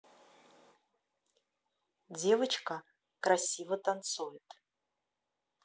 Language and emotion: Russian, neutral